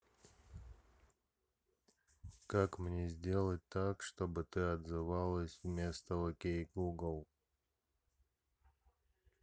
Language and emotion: Russian, neutral